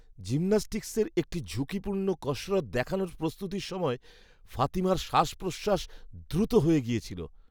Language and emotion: Bengali, fearful